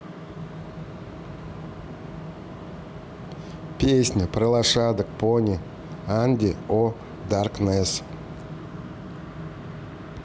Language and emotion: Russian, neutral